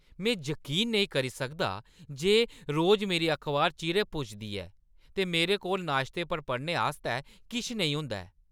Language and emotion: Dogri, angry